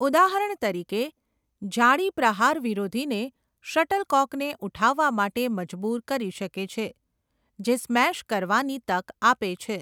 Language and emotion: Gujarati, neutral